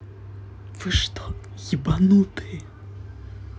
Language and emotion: Russian, neutral